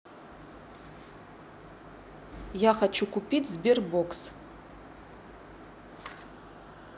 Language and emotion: Russian, neutral